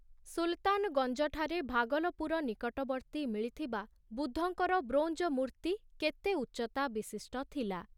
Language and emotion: Odia, neutral